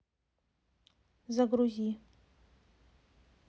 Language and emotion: Russian, neutral